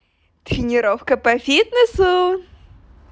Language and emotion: Russian, positive